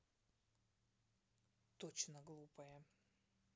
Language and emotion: Russian, neutral